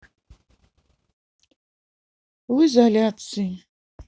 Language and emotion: Russian, sad